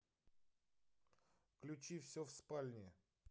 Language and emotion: Russian, neutral